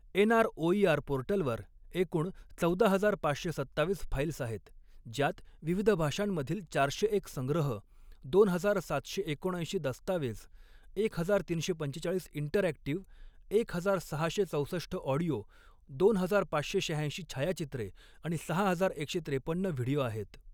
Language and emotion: Marathi, neutral